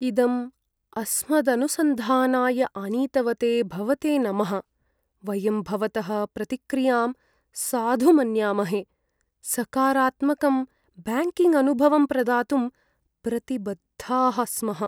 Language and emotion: Sanskrit, sad